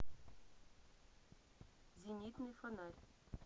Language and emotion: Russian, neutral